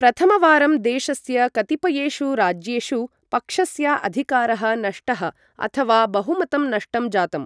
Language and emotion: Sanskrit, neutral